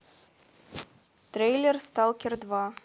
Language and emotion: Russian, neutral